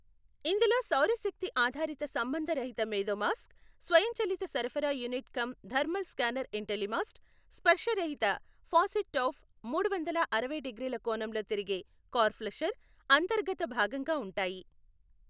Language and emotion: Telugu, neutral